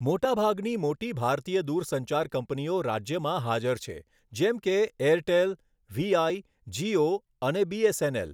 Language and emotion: Gujarati, neutral